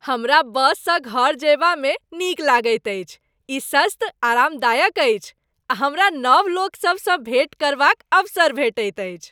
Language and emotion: Maithili, happy